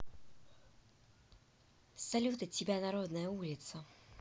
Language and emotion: Russian, positive